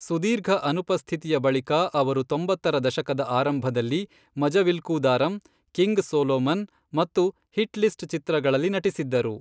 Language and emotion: Kannada, neutral